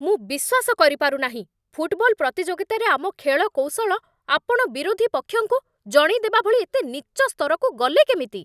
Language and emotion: Odia, angry